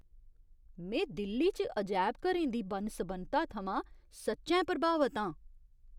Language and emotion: Dogri, surprised